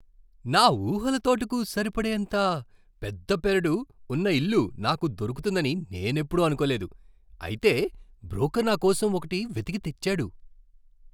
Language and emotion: Telugu, surprised